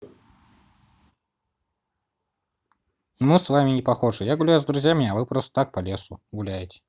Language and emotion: Russian, neutral